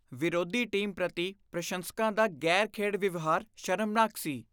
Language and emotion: Punjabi, disgusted